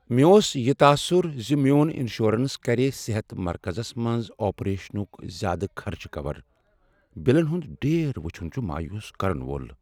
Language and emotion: Kashmiri, sad